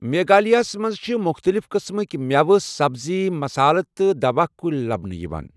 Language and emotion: Kashmiri, neutral